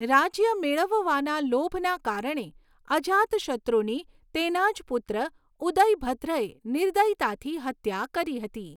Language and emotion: Gujarati, neutral